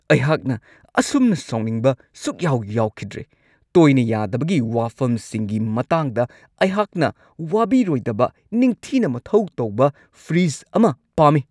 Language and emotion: Manipuri, angry